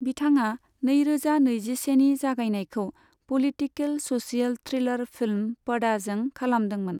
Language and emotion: Bodo, neutral